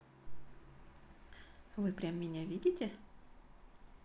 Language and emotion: Russian, positive